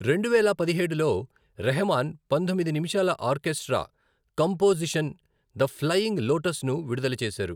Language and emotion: Telugu, neutral